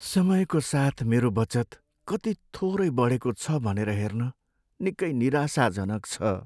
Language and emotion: Nepali, sad